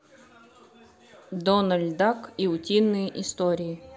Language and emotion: Russian, neutral